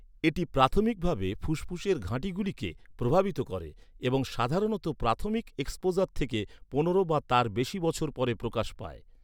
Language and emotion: Bengali, neutral